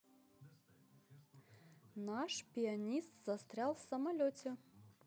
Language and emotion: Russian, positive